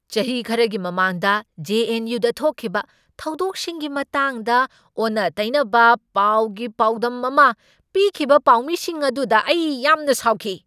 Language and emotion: Manipuri, angry